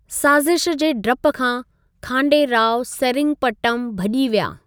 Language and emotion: Sindhi, neutral